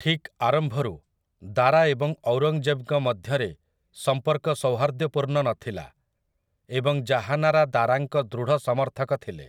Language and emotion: Odia, neutral